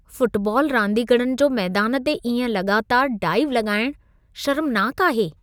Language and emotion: Sindhi, disgusted